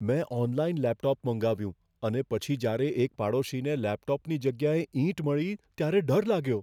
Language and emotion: Gujarati, fearful